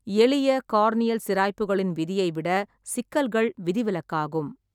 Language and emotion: Tamil, neutral